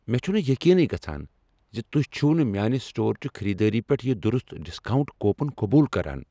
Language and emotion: Kashmiri, angry